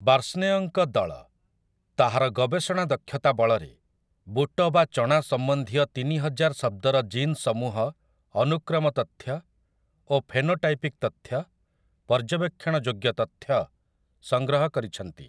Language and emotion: Odia, neutral